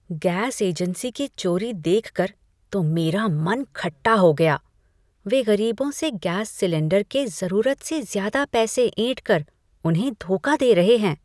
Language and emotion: Hindi, disgusted